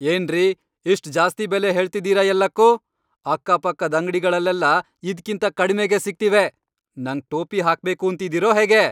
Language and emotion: Kannada, angry